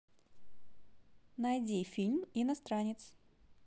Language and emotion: Russian, positive